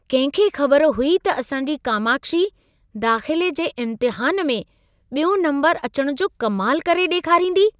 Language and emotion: Sindhi, surprised